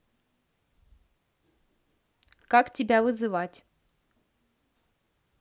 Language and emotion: Russian, neutral